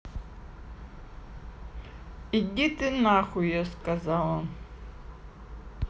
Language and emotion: Russian, neutral